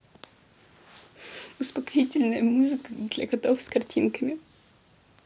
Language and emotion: Russian, sad